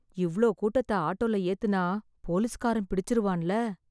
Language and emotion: Tamil, fearful